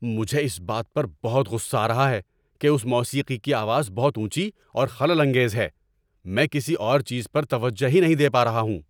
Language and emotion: Urdu, angry